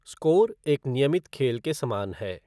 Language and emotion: Hindi, neutral